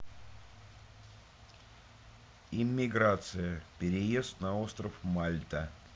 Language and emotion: Russian, neutral